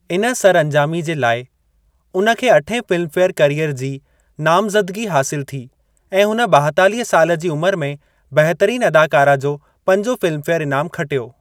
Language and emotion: Sindhi, neutral